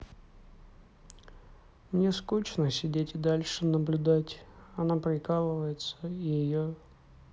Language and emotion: Russian, sad